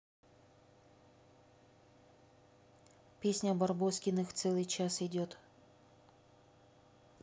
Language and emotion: Russian, neutral